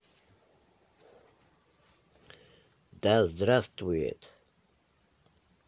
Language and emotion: Russian, neutral